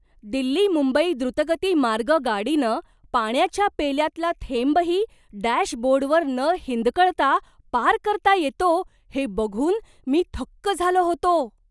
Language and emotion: Marathi, surprised